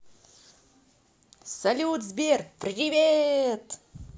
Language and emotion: Russian, positive